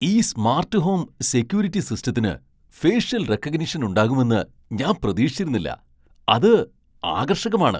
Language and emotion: Malayalam, surprised